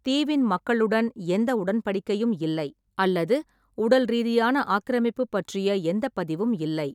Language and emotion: Tamil, neutral